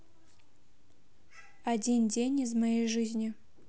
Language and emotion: Russian, neutral